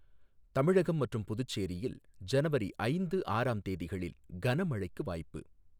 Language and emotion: Tamil, neutral